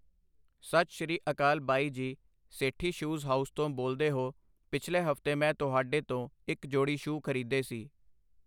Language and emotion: Punjabi, neutral